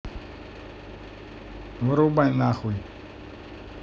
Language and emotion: Russian, neutral